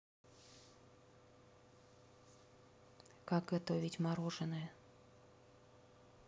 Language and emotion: Russian, neutral